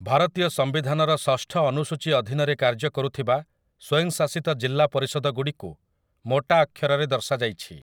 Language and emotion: Odia, neutral